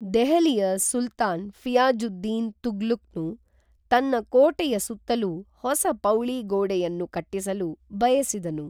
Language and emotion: Kannada, neutral